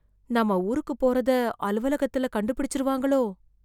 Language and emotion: Tamil, fearful